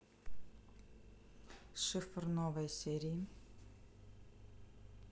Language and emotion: Russian, neutral